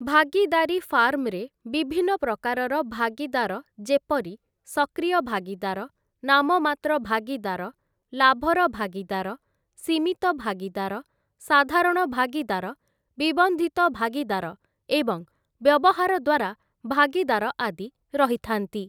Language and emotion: Odia, neutral